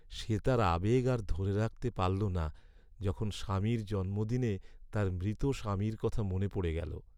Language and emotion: Bengali, sad